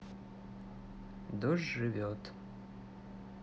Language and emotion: Russian, neutral